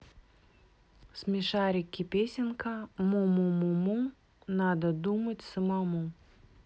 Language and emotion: Russian, neutral